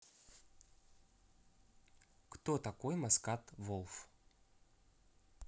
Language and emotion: Russian, neutral